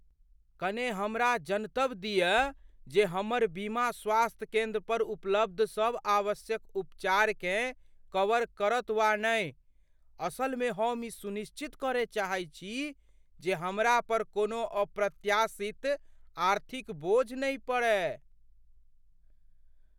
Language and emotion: Maithili, fearful